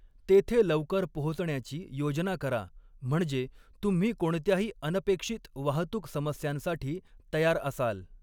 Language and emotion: Marathi, neutral